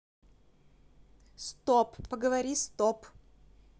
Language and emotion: Russian, neutral